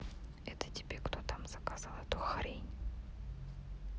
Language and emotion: Russian, neutral